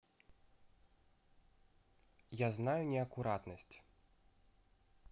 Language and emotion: Russian, neutral